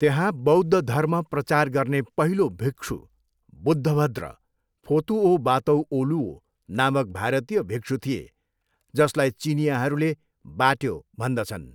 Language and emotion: Nepali, neutral